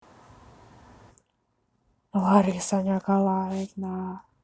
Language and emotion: Russian, neutral